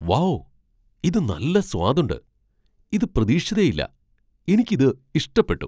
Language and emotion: Malayalam, surprised